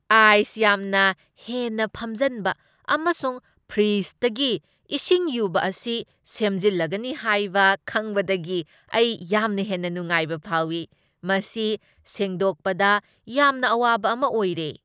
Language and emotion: Manipuri, happy